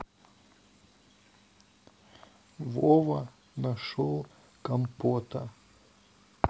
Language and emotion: Russian, sad